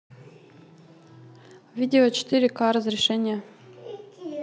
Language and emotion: Russian, neutral